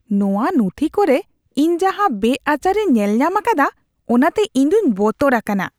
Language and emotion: Santali, disgusted